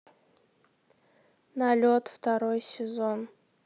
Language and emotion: Russian, neutral